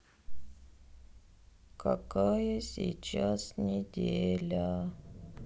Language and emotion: Russian, sad